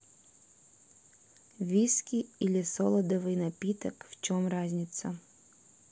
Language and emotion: Russian, neutral